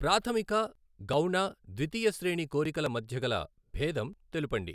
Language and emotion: Telugu, neutral